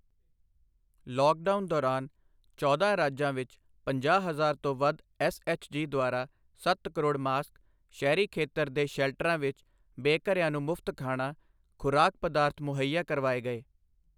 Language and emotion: Punjabi, neutral